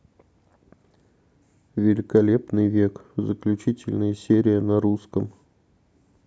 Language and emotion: Russian, neutral